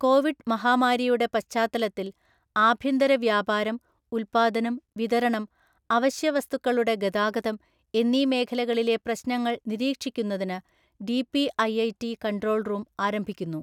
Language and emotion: Malayalam, neutral